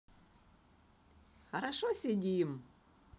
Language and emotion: Russian, positive